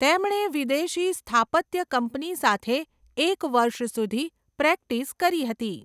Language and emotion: Gujarati, neutral